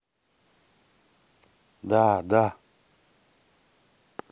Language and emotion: Russian, neutral